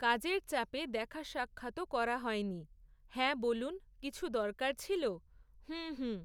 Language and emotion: Bengali, neutral